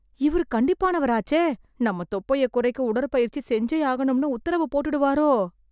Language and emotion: Tamil, fearful